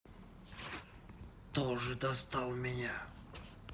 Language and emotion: Russian, angry